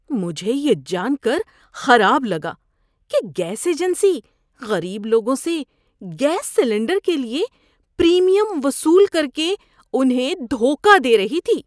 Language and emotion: Urdu, disgusted